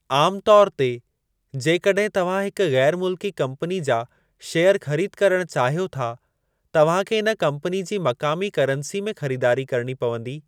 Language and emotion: Sindhi, neutral